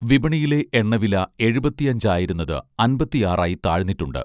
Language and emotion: Malayalam, neutral